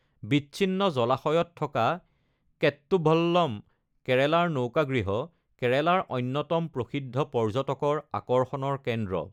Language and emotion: Assamese, neutral